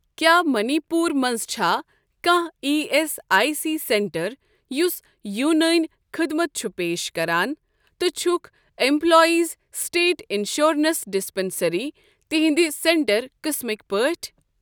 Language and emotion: Kashmiri, neutral